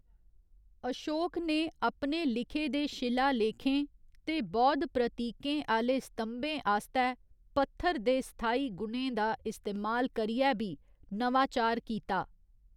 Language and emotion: Dogri, neutral